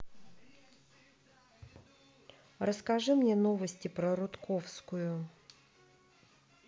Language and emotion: Russian, neutral